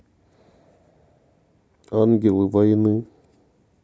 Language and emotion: Russian, sad